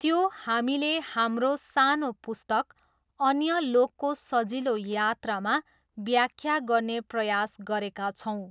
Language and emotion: Nepali, neutral